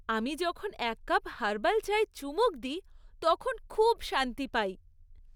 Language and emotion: Bengali, happy